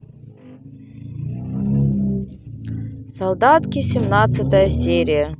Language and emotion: Russian, neutral